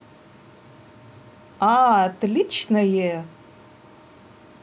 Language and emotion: Russian, positive